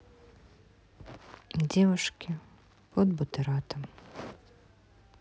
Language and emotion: Russian, sad